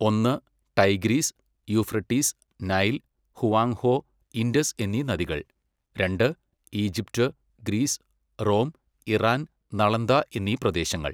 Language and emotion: Malayalam, neutral